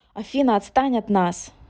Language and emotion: Russian, angry